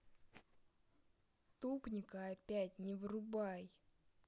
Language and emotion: Russian, angry